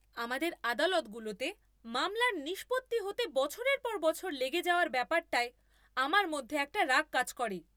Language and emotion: Bengali, angry